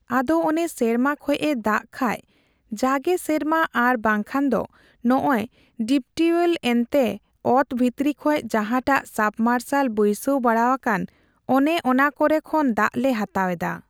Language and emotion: Santali, neutral